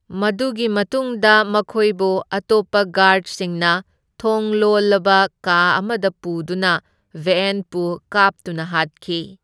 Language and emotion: Manipuri, neutral